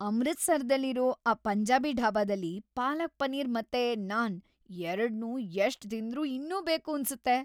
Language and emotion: Kannada, happy